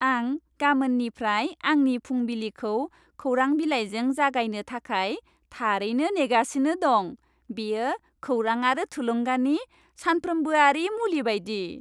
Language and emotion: Bodo, happy